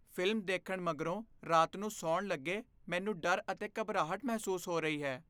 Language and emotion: Punjabi, fearful